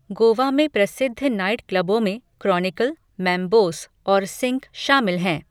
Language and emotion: Hindi, neutral